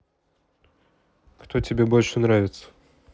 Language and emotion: Russian, neutral